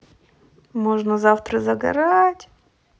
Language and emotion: Russian, positive